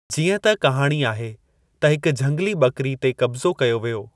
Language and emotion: Sindhi, neutral